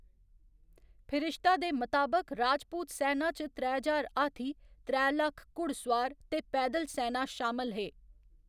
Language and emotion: Dogri, neutral